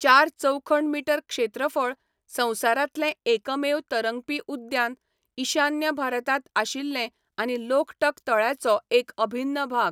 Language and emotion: Goan Konkani, neutral